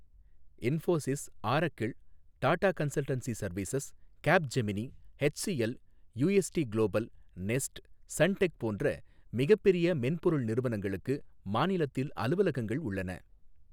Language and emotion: Tamil, neutral